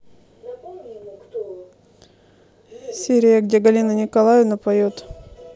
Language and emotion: Russian, neutral